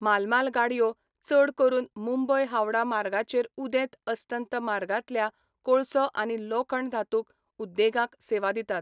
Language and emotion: Goan Konkani, neutral